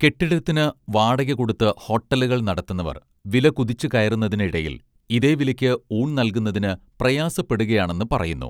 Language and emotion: Malayalam, neutral